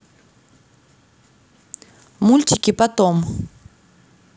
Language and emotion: Russian, neutral